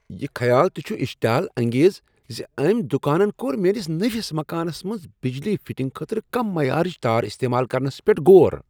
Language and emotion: Kashmiri, disgusted